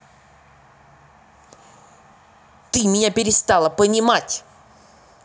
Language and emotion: Russian, angry